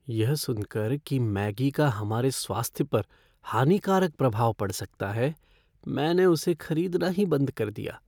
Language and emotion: Hindi, fearful